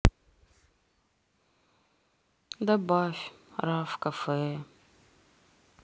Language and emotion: Russian, sad